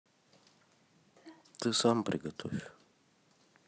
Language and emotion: Russian, neutral